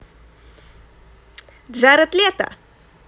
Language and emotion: Russian, positive